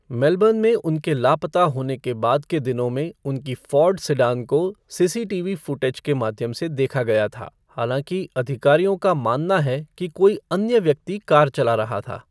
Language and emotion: Hindi, neutral